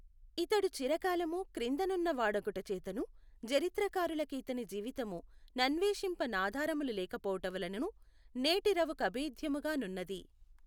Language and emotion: Telugu, neutral